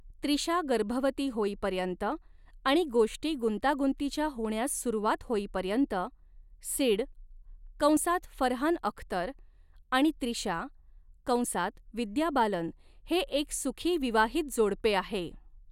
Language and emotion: Marathi, neutral